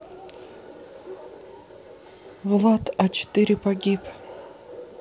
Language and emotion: Russian, sad